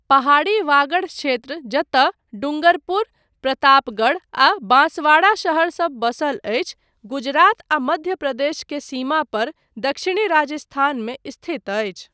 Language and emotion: Maithili, neutral